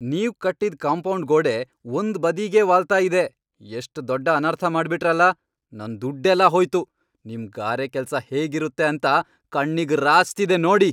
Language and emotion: Kannada, angry